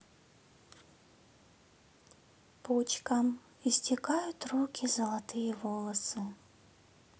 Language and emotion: Russian, neutral